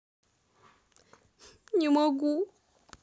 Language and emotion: Russian, sad